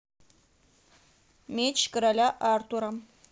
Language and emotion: Russian, neutral